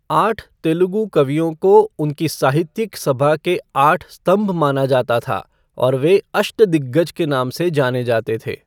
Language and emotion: Hindi, neutral